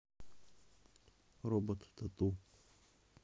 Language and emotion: Russian, neutral